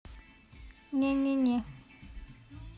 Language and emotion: Russian, neutral